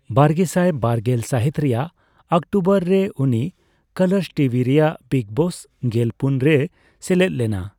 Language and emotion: Santali, neutral